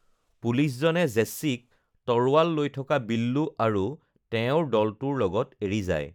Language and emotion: Assamese, neutral